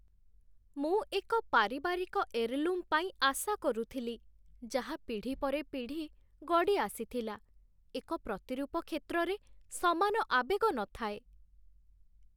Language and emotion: Odia, sad